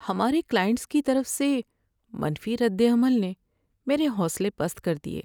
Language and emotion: Urdu, sad